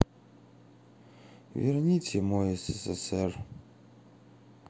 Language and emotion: Russian, sad